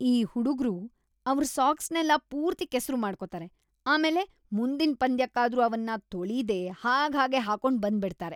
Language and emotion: Kannada, disgusted